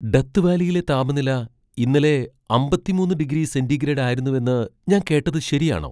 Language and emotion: Malayalam, surprised